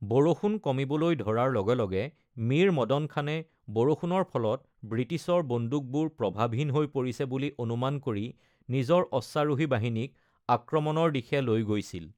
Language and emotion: Assamese, neutral